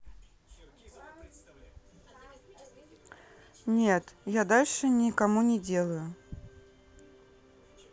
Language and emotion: Russian, neutral